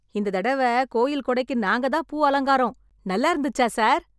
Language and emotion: Tamil, happy